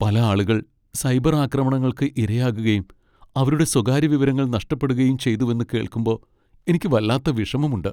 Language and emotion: Malayalam, sad